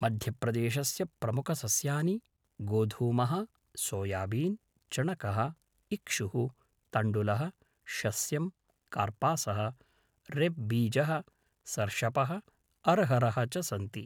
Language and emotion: Sanskrit, neutral